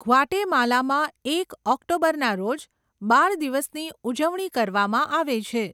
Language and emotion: Gujarati, neutral